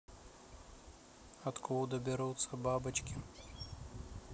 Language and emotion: Russian, neutral